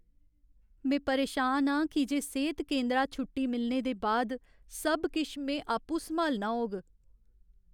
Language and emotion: Dogri, sad